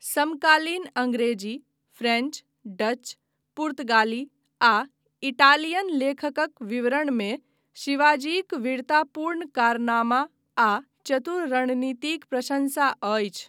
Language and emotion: Maithili, neutral